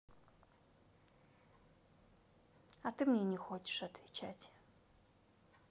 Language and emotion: Russian, sad